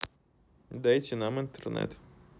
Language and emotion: Russian, neutral